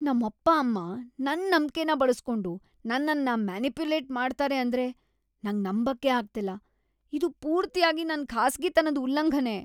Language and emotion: Kannada, disgusted